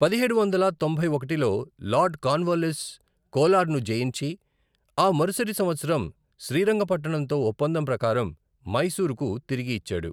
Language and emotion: Telugu, neutral